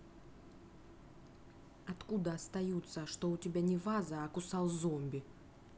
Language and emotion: Russian, angry